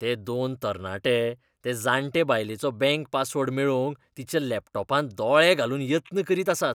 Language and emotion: Goan Konkani, disgusted